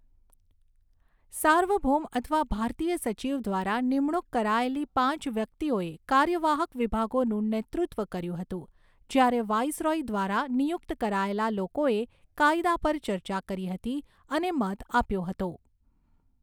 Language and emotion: Gujarati, neutral